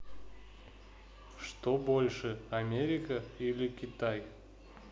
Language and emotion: Russian, neutral